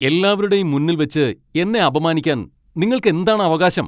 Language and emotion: Malayalam, angry